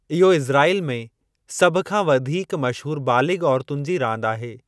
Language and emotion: Sindhi, neutral